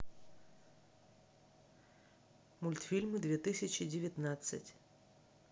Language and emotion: Russian, neutral